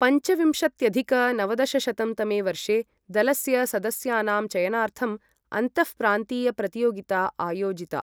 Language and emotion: Sanskrit, neutral